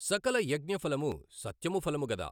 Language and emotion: Telugu, neutral